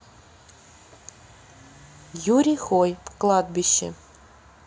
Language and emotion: Russian, neutral